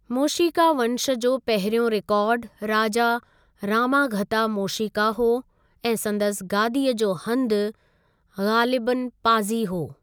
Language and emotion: Sindhi, neutral